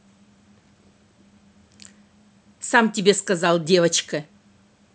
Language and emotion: Russian, angry